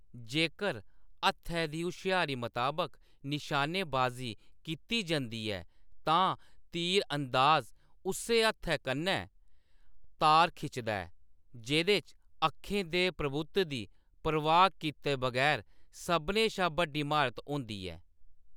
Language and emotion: Dogri, neutral